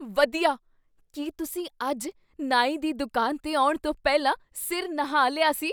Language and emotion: Punjabi, surprised